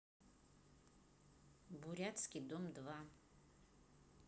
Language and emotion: Russian, neutral